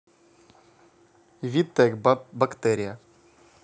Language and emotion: Russian, neutral